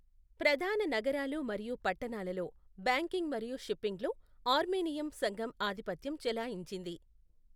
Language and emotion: Telugu, neutral